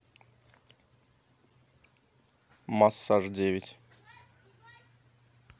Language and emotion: Russian, neutral